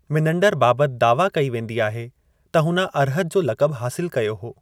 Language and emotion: Sindhi, neutral